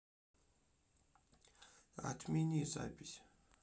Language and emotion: Russian, neutral